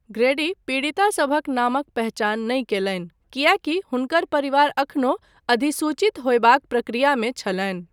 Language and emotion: Maithili, neutral